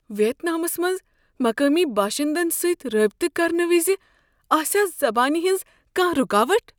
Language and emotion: Kashmiri, fearful